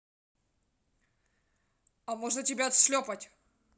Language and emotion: Russian, angry